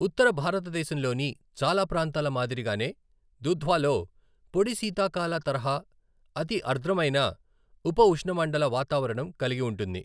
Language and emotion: Telugu, neutral